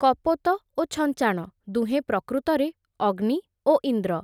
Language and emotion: Odia, neutral